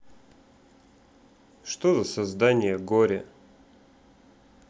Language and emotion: Russian, neutral